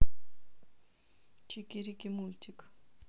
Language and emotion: Russian, neutral